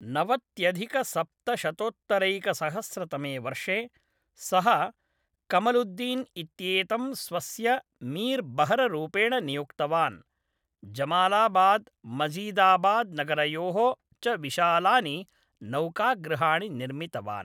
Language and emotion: Sanskrit, neutral